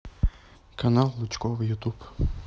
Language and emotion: Russian, neutral